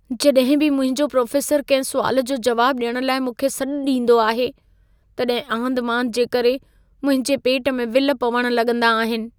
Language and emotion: Sindhi, fearful